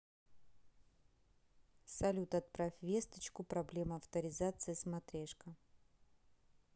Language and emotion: Russian, neutral